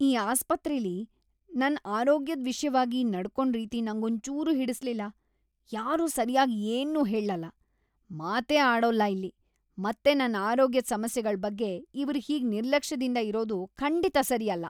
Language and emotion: Kannada, disgusted